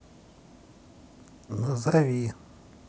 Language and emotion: Russian, neutral